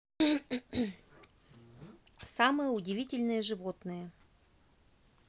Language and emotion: Russian, neutral